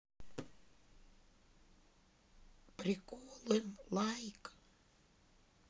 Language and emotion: Russian, sad